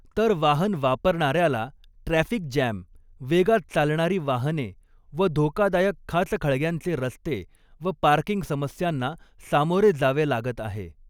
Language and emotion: Marathi, neutral